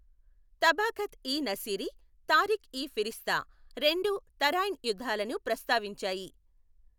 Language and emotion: Telugu, neutral